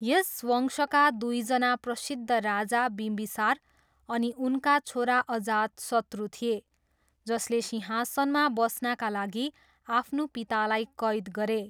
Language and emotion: Nepali, neutral